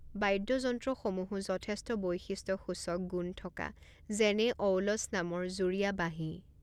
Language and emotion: Assamese, neutral